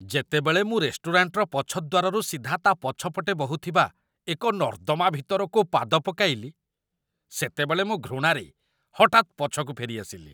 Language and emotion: Odia, disgusted